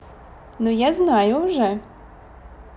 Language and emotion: Russian, positive